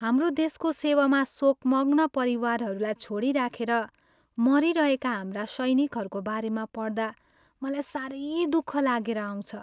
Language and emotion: Nepali, sad